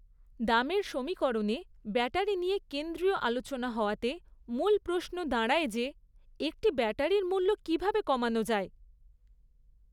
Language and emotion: Bengali, neutral